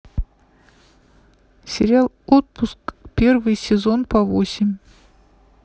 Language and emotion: Russian, neutral